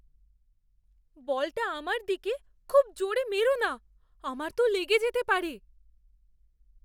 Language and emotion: Bengali, fearful